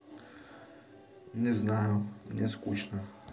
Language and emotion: Russian, neutral